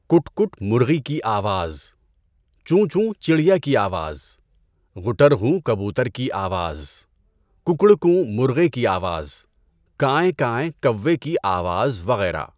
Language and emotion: Urdu, neutral